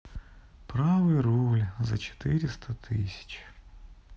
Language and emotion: Russian, sad